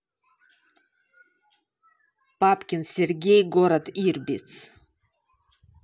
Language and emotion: Russian, neutral